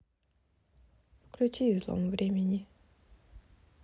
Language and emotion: Russian, neutral